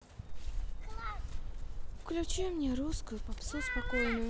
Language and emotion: Russian, sad